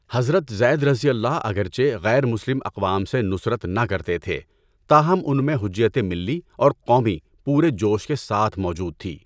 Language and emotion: Urdu, neutral